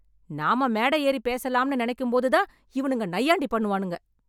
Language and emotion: Tamil, angry